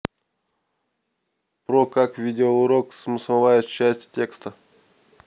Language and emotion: Russian, neutral